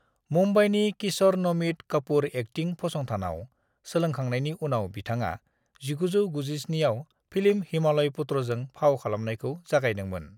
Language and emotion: Bodo, neutral